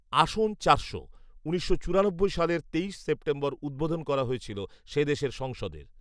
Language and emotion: Bengali, neutral